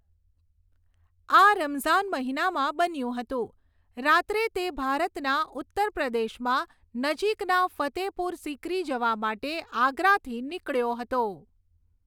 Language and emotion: Gujarati, neutral